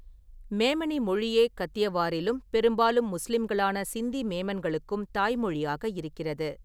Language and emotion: Tamil, neutral